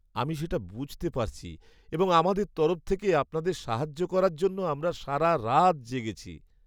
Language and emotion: Bengali, sad